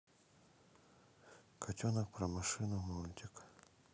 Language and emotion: Russian, neutral